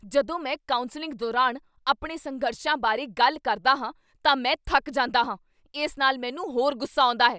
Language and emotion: Punjabi, angry